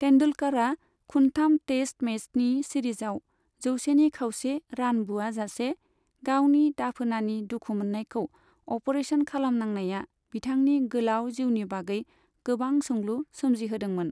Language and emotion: Bodo, neutral